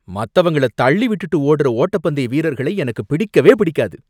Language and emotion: Tamil, angry